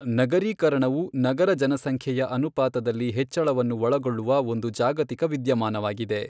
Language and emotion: Kannada, neutral